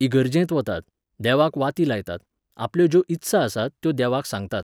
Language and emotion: Goan Konkani, neutral